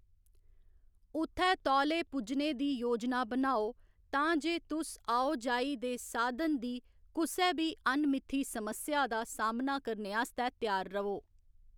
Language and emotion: Dogri, neutral